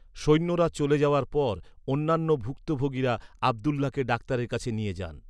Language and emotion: Bengali, neutral